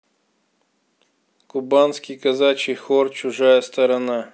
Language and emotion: Russian, neutral